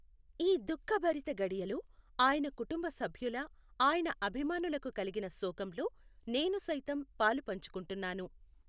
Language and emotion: Telugu, neutral